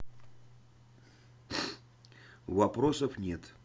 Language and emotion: Russian, neutral